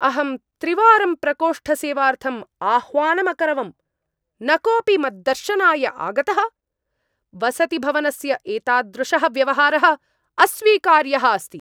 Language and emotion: Sanskrit, angry